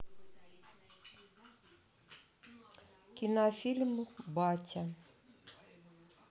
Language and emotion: Russian, neutral